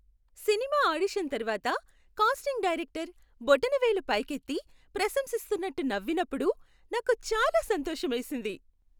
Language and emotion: Telugu, happy